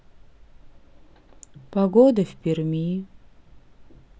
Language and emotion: Russian, sad